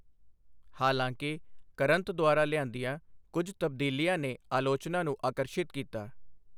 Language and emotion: Punjabi, neutral